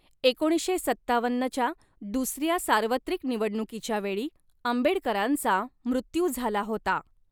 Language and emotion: Marathi, neutral